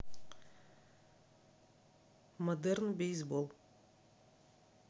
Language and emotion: Russian, neutral